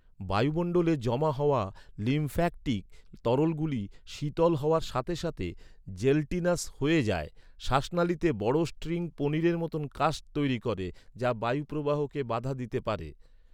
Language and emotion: Bengali, neutral